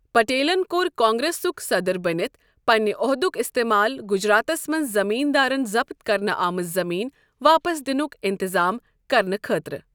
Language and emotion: Kashmiri, neutral